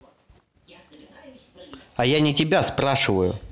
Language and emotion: Russian, angry